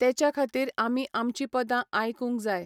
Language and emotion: Goan Konkani, neutral